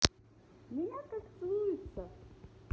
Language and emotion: Russian, positive